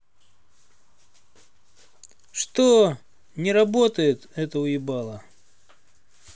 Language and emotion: Russian, angry